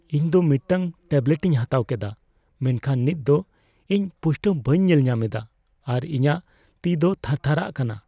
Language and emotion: Santali, fearful